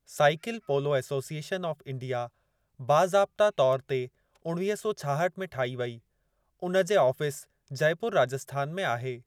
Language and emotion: Sindhi, neutral